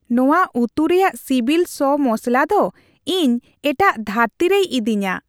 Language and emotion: Santali, happy